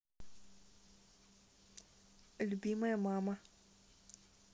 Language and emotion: Russian, neutral